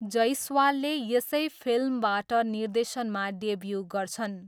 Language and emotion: Nepali, neutral